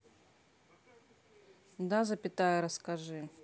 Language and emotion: Russian, neutral